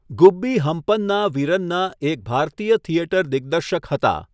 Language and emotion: Gujarati, neutral